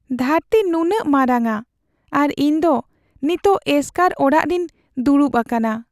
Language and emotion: Santali, sad